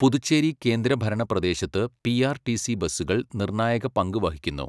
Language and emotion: Malayalam, neutral